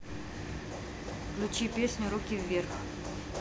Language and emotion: Russian, neutral